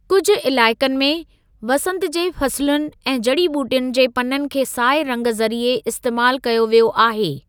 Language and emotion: Sindhi, neutral